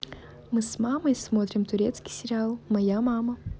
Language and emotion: Russian, positive